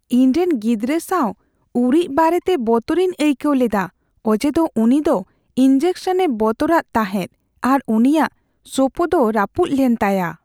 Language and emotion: Santali, fearful